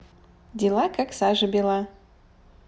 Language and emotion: Russian, positive